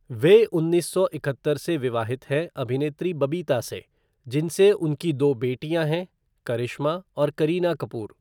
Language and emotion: Hindi, neutral